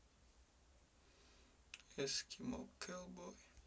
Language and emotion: Russian, sad